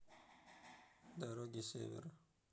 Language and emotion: Russian, neutral